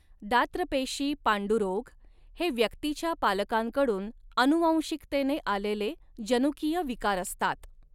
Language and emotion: Marathi, neutral